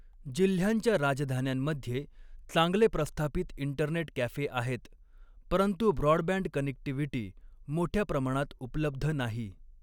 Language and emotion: Marathi, neutral